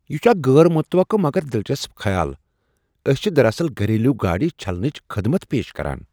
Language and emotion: Kashmiri, surprised